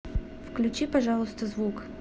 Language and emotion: Russian, neutral